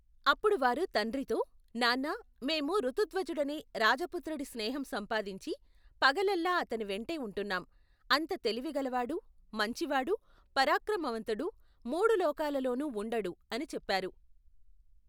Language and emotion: Telugu, neutral